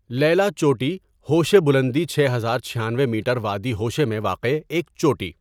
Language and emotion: Urdu, neutral